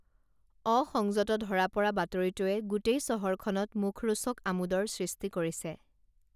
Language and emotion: Assamese, neutral